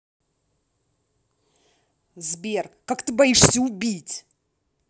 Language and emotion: Russian, angry